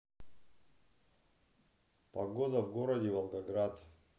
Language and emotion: Russian, neutral